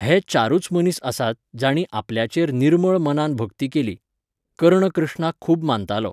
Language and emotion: Goan Konkani, neutral